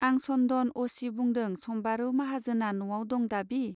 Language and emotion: Bodo, neutral